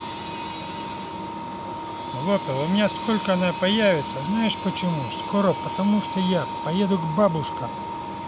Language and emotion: Russian, neutral